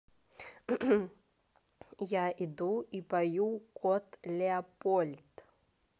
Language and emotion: Russian, neutral